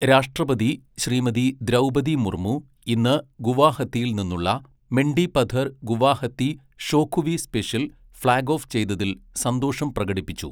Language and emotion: Malayalam, neutral